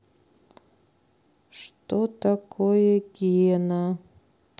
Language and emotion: Russian, sad